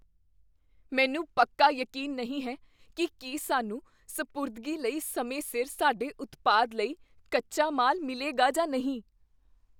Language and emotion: Punjabi, fearful